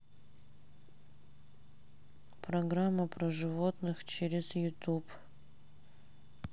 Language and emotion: Russian, sad